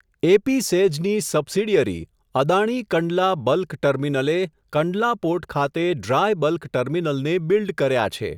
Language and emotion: Gujarati, neutral